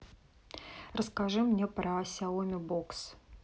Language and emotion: Russian, neutral